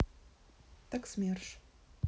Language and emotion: Russian, neutral